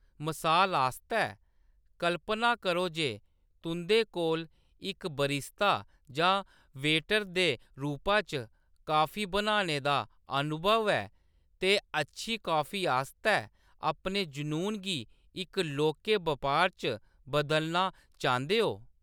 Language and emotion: Dogri, neutral